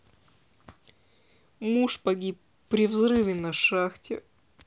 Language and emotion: Russian, sad